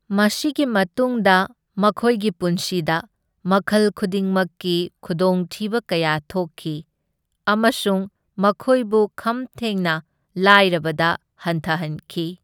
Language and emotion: Manipuri, neutral